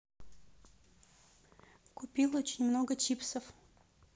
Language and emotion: Russian, neutral